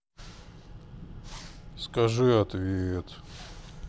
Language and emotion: Russian, sad